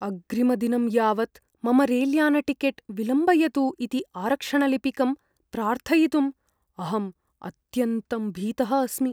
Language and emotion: Sanskrit, fearful